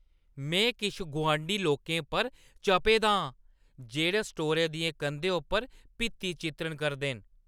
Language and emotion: Dogri, angry